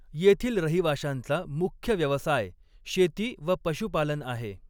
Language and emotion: Marathi, neutral